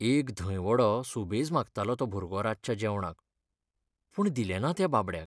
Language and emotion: Goan Konkani, sad